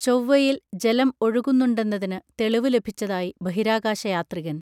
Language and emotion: Malayalam, neutral